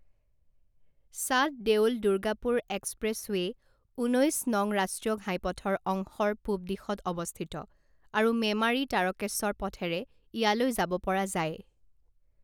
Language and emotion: Assamese, neutral